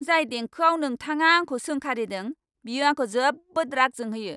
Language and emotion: Bodo, angry